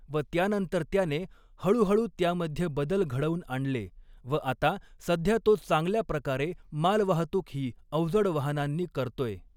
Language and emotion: Marathi, neutral